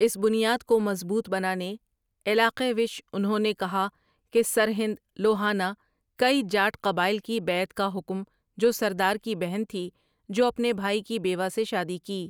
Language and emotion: Urdu, neutral